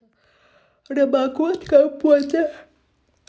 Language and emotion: Russian, neutral